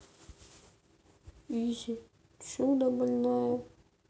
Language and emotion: Russian, sad